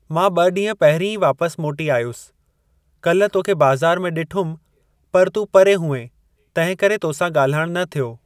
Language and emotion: Sindhi, neutral